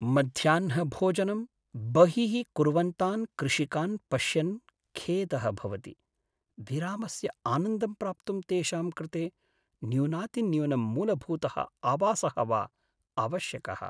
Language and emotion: Sanskrit, sad